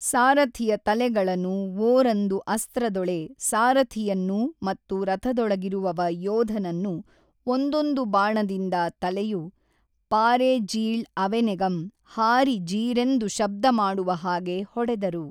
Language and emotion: Kannada, neutral